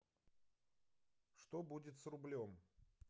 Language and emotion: Russian, neutral